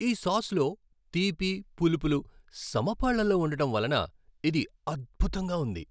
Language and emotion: Telugu, happy